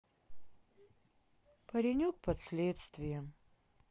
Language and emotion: Russian, sad